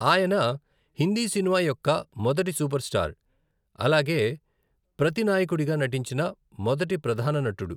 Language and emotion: Telugu, neutral